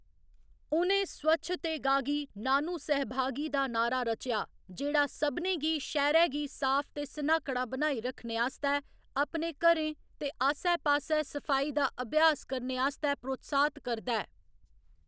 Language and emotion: Dogri, neutral